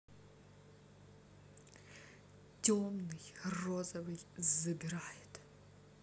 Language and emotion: Russian, neutral